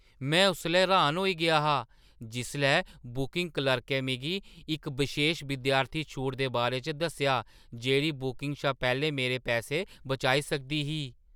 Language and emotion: Dogri, surprised